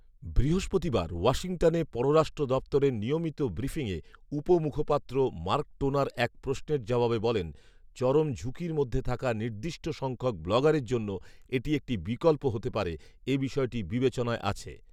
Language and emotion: Bengali, neutral